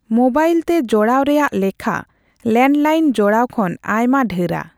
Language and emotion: Santali, neutral